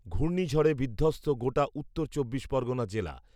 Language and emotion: Bengali, neutral